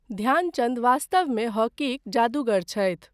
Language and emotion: Maithili, neutral